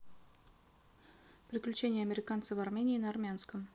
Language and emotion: Russian, neutral